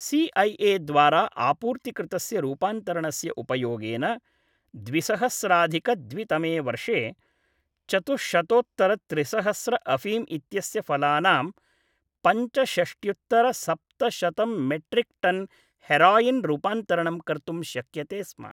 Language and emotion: Sanskrit, neutral